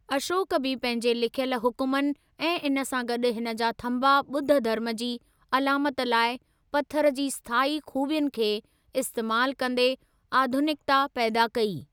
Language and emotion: Sindhi, neutral